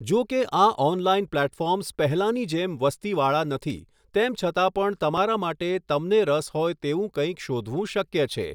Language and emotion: Gujarati, neutral